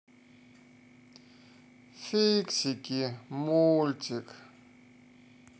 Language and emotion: Russian, sad